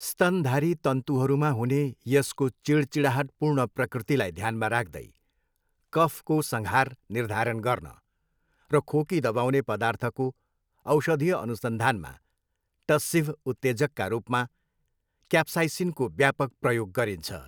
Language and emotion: Nepali, neutral